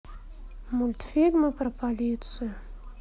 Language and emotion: Russian, sad